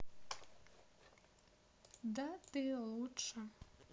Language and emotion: Russian, positive